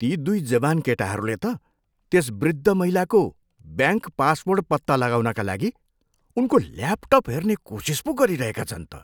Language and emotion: Nepali, disgusted